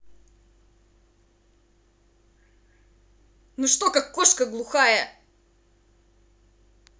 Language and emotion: Russian, angry